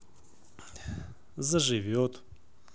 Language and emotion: Russian, positive